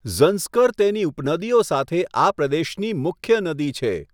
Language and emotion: Gujarati, neutral